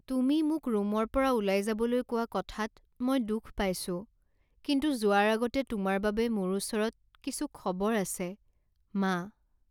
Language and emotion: Assamese, sad